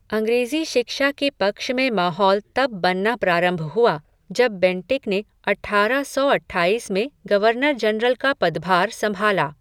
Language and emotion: Hindi, neutral